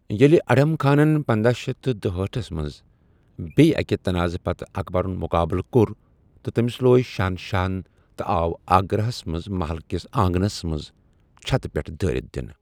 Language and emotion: Kashmiri, neutral